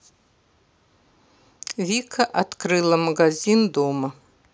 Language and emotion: Russian, neutral